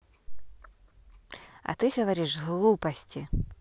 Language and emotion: Russian, neutral